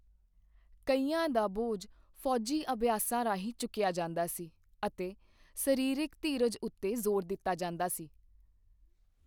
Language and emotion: Punjabi, neutral